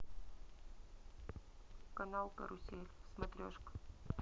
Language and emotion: Russian, neutral